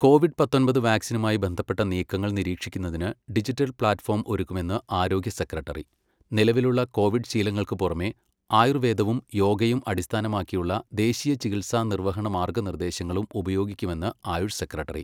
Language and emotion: Malayalam, neutral